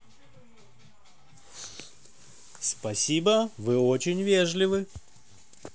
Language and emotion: Russian, positive